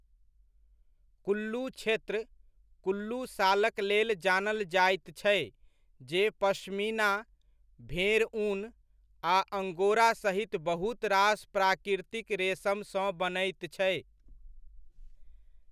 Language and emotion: Maithili, neutral